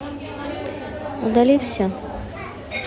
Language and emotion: Russian, neutral